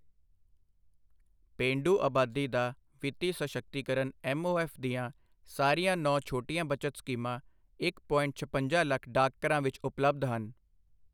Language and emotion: Punjabi, neutral